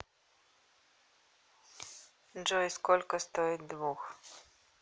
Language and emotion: Russian, neutral